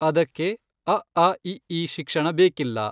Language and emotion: Kannada, neutral